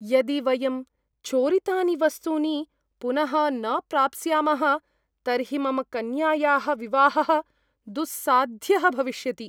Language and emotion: Sanskrit, fearful